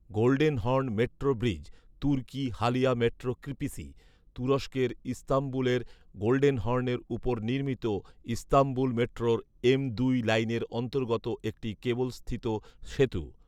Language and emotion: Bengali, neutral